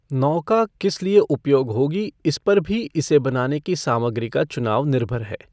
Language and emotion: Hindi, neutral